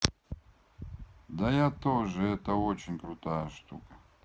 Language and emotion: Russian, neutral